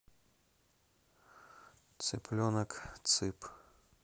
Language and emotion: Russian, neutral